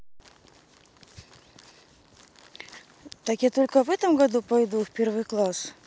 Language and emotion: Russian, neutral